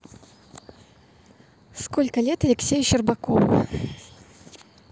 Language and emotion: Russian, neutral